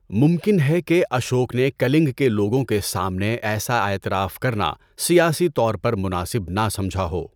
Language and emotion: Urdu, neutral